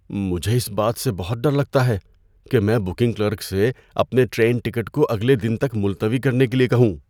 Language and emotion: Urdu, fearful